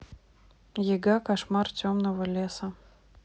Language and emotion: Russian, neutral